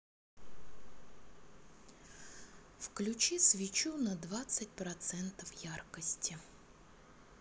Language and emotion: Russian, neutral